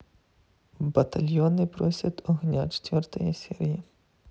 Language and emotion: Russian, neutral